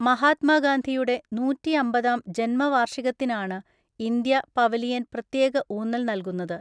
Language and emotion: Malayalam, neutral